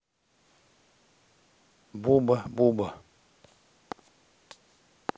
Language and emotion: Russian, neutral